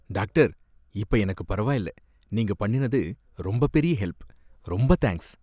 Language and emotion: Tamil, happy